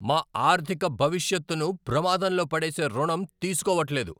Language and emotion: Telugu, angry